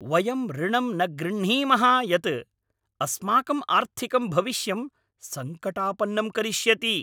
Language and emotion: Sanskrit, angry